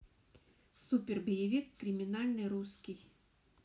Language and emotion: Russian, neutral